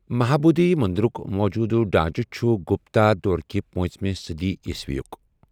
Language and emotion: Kashmiri, neutral